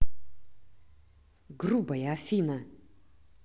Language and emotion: Russian, angry